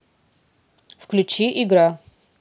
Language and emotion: Russian, neutral